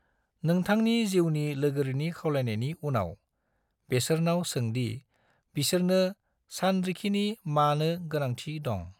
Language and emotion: Bodo, neutral